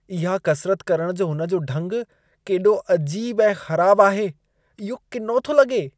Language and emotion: Sindhi, disgusted